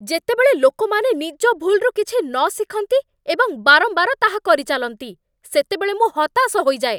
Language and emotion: Odia, angry